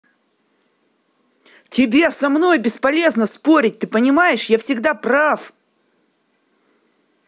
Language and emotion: Russian, angry